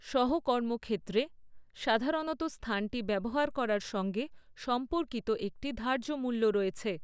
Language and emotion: Bengali, neutral